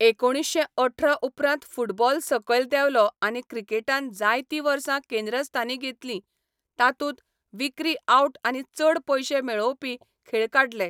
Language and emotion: Goan Konkani, neutral